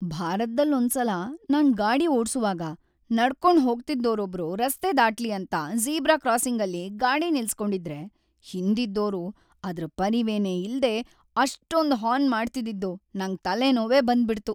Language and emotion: Kannada, sad